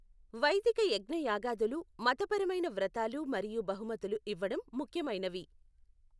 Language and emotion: Telugu, neutral